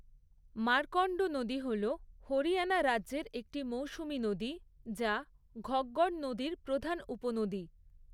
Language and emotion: Bengali, neutral